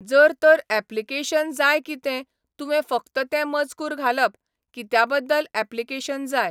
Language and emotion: Goan Konkani, neutral